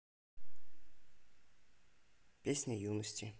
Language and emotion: Russian, neutral